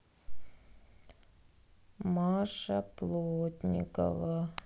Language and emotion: Russian, sad